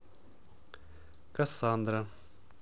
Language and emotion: Russian, neutral